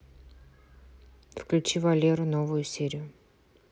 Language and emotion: Russian, neutral